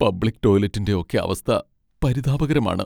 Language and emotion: Malayalam, sad